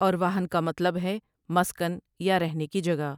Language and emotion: Urdu, neutral